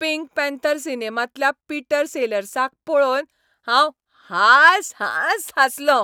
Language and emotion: Goan Konkani, happy